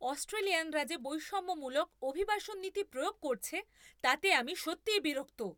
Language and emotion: Bengali, angry